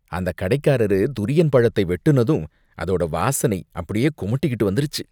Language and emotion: Tamil, disgusted